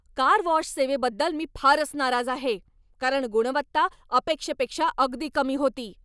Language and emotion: Marathi, angry